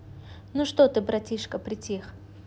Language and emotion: Russian, positive